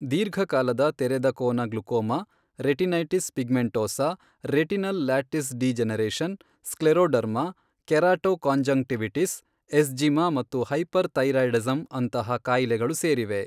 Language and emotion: Kannada, neutral